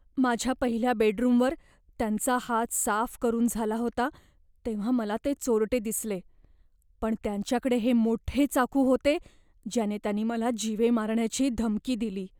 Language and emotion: Marathi, fearful